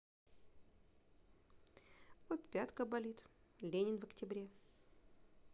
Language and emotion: Russian, neutral